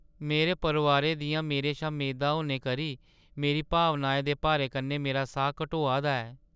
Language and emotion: Dogri, sad